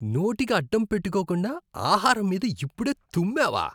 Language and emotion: Telugu, disgusted